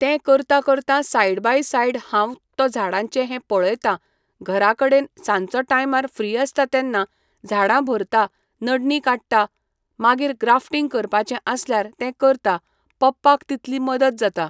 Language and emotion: Goan Konkani, neutral